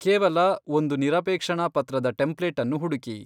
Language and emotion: Kannada, neutral